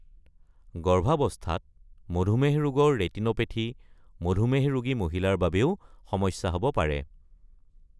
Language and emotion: Assamese, neutral